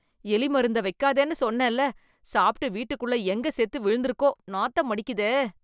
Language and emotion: Tamil, disgusted